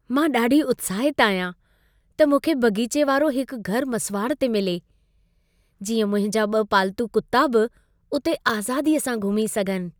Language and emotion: Sindhi, happy